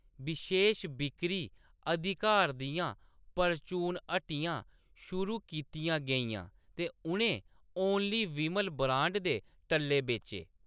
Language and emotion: Dogri, neutral